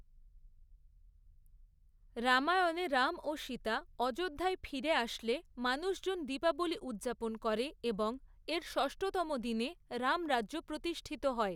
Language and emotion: Bengali, neutral